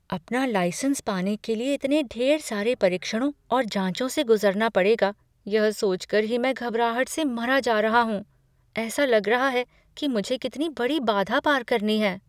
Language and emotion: Hindi, fearful